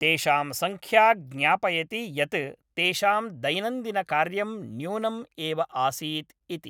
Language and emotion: Sanskrit, neutral